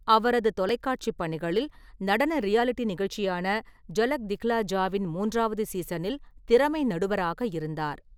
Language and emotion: Tamil, neutral